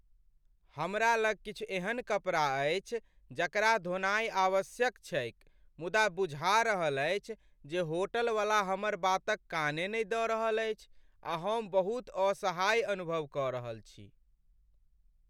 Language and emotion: Maithili, sad